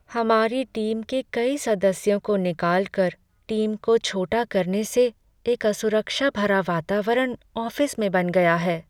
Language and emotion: Hindi, sad